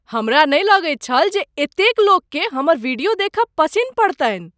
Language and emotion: Maithili, surprised